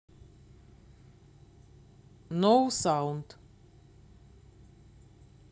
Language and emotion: Russian, neutral